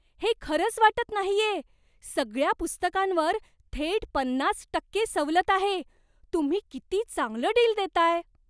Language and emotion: Marathi, surprised